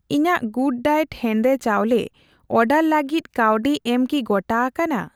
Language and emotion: Santali, neutral